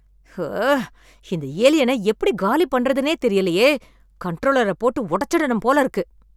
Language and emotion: Tamil, angry